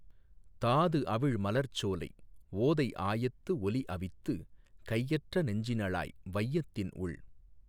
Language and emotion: Tamil, neutral